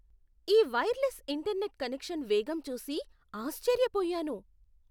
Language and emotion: Telugu, surprised